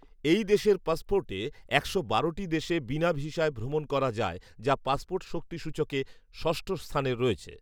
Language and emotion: Bengali, neutral